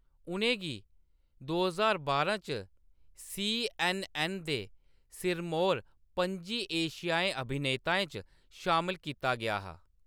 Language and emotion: Dogri, neutral